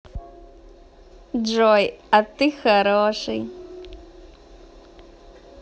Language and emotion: Russian, positive